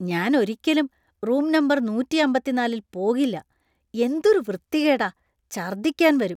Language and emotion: Malayalam, disgusted